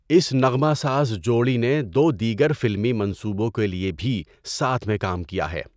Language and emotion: Urdu, neutral